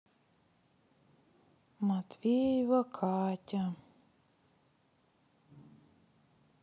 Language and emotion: Russian, sad